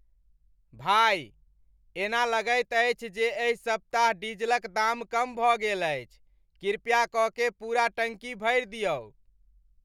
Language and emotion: Maithili, happy